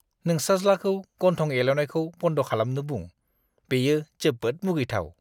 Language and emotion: Bodo, disgusted